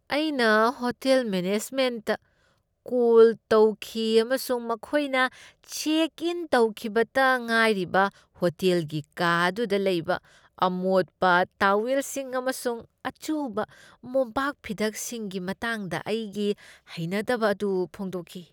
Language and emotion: Manipuri, disgusted